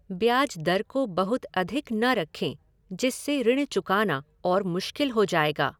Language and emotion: Hindi, neutral